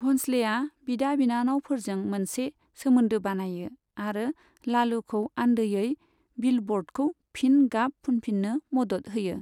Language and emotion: Bodo, neutral